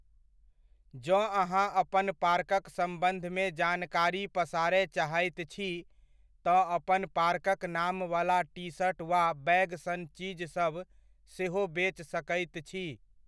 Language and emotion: Maithili, neutral